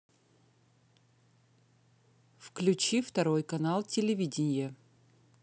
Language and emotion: Russian, neutral